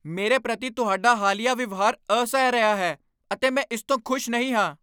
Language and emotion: Punjabi, angry